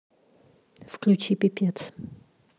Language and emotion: Russian, neutral